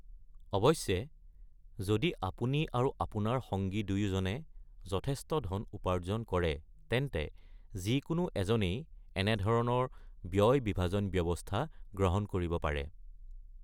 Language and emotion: Assamese, neutral